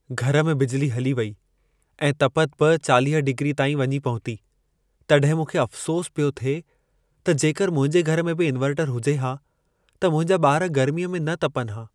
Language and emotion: Sindhi, sad